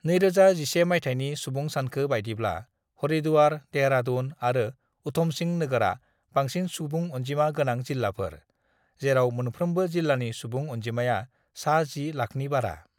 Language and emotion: Bodo, neutral